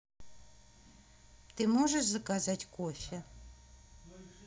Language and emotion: Russian, neutral